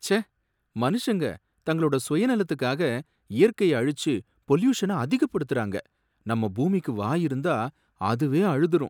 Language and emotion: Tamil, sad